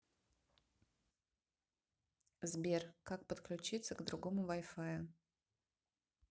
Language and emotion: Russian, neutral